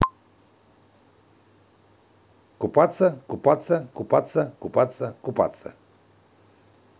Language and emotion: Russian, positive